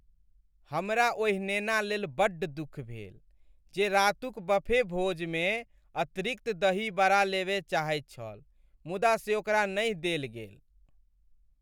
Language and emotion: Maithili, sad